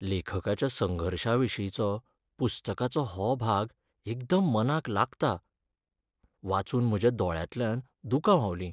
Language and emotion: Goan Konkani, sad